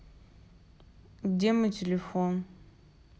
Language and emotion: Russian, sad